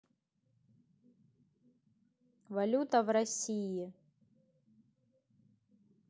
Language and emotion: Russian, neutral